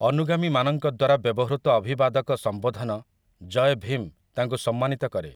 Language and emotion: Odia, neutral